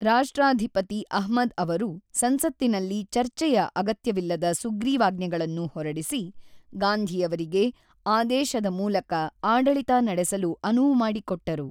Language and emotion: Kannada, neutral